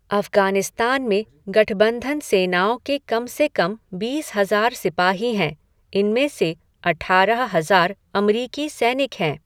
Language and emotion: Hindi, neutral